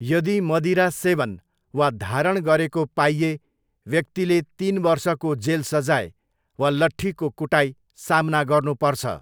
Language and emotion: Nepali, neutral